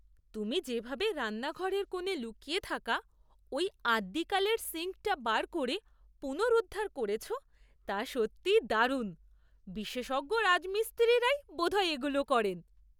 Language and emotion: Bengali, surprised